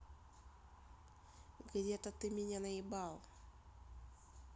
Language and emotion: Russian, neutral